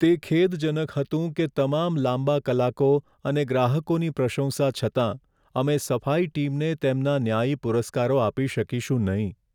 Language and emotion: Gujarati, sad